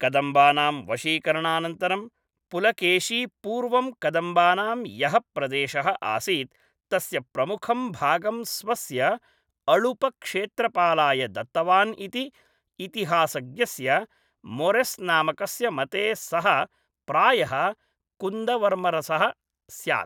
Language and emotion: Sanskrit, neutral